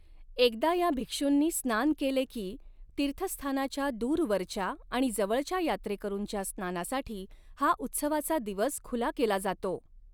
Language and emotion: Marathi, neutral